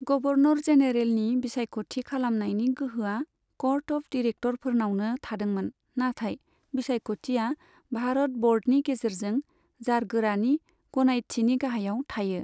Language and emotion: Bodo, neutral